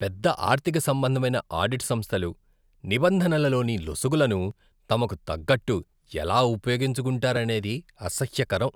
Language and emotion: Telugu, disgusted